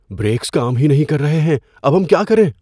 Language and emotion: Urdu, fearful